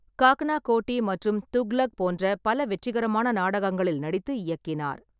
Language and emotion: Tamil, neutral